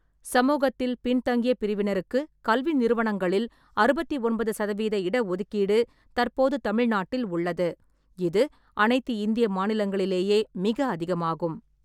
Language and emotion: Tamil, neutral